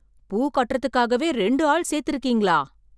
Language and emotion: Tamil, surprised